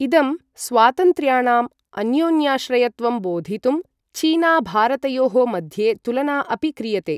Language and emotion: Sanskrit, neutral